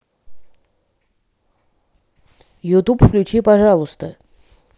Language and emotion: Russian, neutral